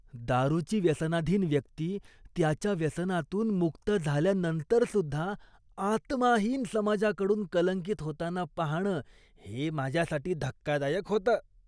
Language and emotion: Marathi, disgusted